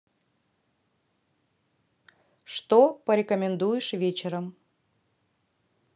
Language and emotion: Russian, neutral